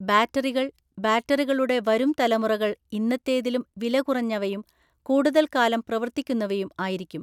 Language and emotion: Malayalam, neutral